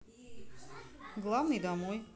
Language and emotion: Russian, neutral